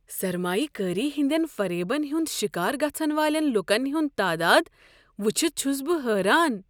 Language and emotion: Kashmiri, surprised